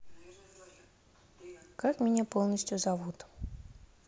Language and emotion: Russian, neutral